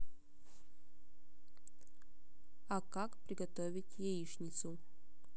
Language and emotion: Russian, neutral